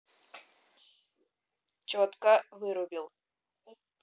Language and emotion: Russian, neutral